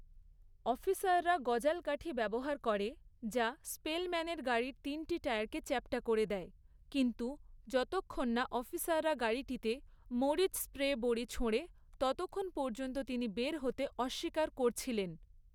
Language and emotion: Bengali, neutral